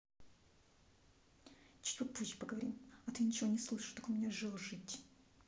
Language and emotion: Russian, angry